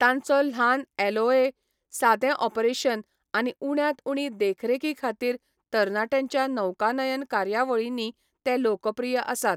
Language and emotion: Goan Konkani, neutral